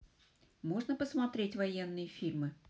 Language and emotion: Russian, neutral